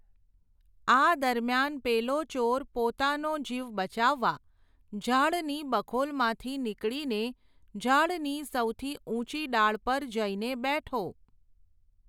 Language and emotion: Gujarati, neutral